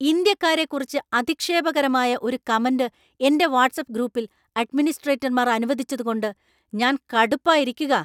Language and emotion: Malayalam, angry